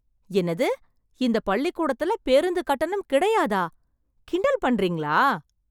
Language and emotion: Tamil, surprised